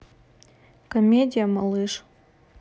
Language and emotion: Russian, neutral